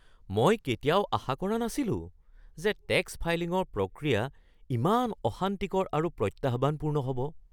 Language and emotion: Assamese, surprised